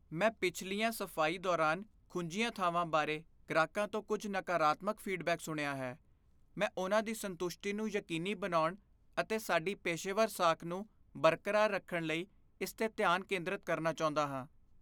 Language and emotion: Punjabi, fearful